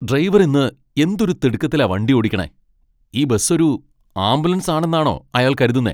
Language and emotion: Malayalam, angry